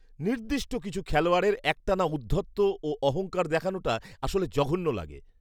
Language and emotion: Bengali, disgusted